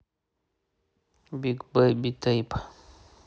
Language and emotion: Russian, neutral